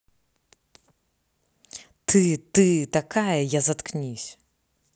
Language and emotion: Russian, angry